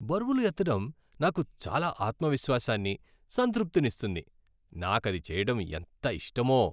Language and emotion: Telugu, happy